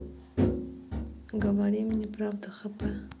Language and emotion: Russian, neutral